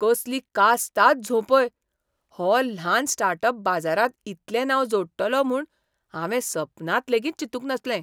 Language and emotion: Goan Konkani, surprised